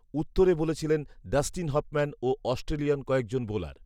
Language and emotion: Bengali, neutral